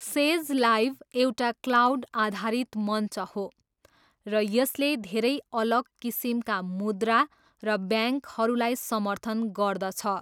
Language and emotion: Nepali, neutral